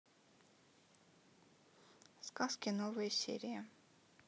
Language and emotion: Russian, neutral